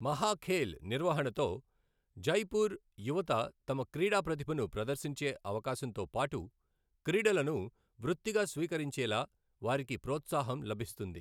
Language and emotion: Telugu, neutral